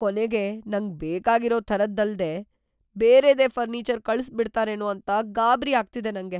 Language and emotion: Kannada, fearful